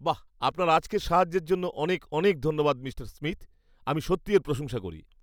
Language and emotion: Bengali, happy